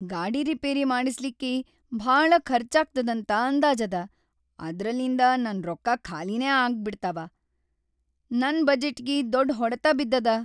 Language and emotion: Kannada, sad